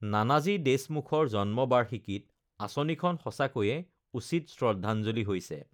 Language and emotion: Assamese, neutral